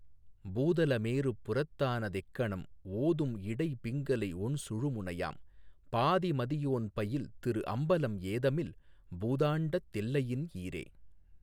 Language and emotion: Tamil, neutral